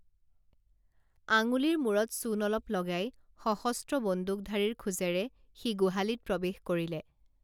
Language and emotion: Assamese, neutral